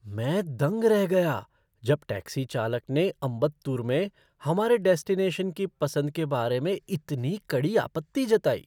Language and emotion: Hindi, surprised